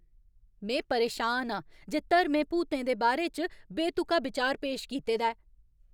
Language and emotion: Dogri, angry